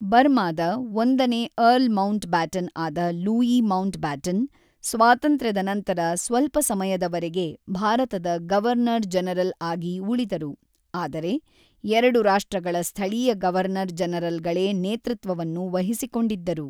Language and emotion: Kannada, neutral